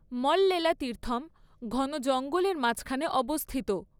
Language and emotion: Bengali, neutral